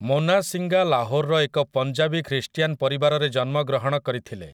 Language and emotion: Odia, neutral